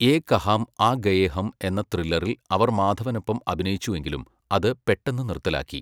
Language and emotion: Malayalam, neutral